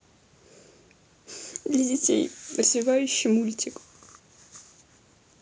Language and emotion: Russian, sad